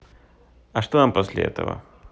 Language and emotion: Russian, neutral